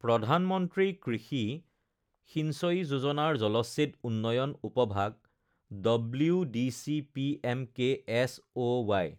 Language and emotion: Assamese, neutral